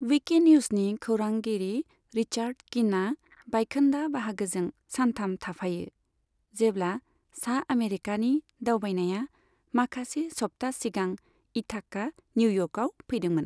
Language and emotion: Bodo, neutral